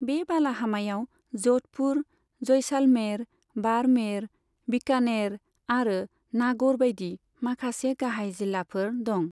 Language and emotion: Bodo, neutral